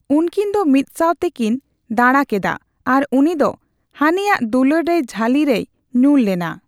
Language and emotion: Santali, neutral